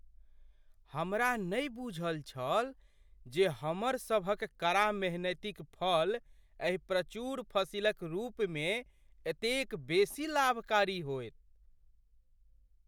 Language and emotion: Maithili, surprised